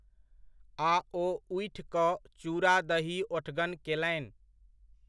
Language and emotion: Maithili, neutral